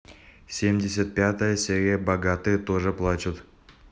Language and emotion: Russian, neutral